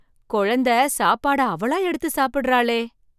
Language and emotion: Tamil, surprised